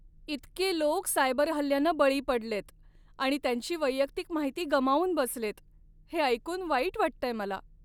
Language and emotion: Marathi, sad